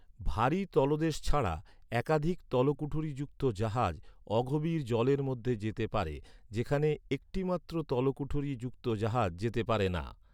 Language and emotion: Bengali, neutral